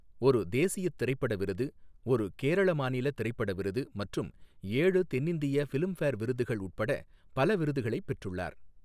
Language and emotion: Tamil, neutral